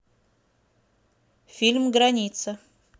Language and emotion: Russian, neutral